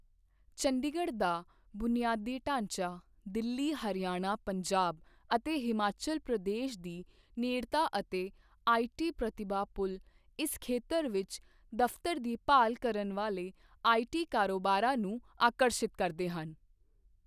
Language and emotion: Punjabi, neutral